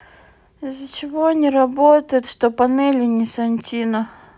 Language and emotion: Russian, sad